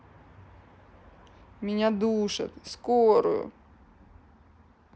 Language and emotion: Russian, sad